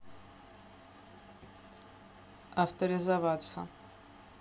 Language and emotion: Russian, neutral